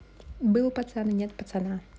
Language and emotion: Russian, neutral